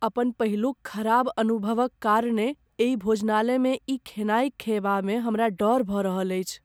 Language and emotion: Maithili, fearful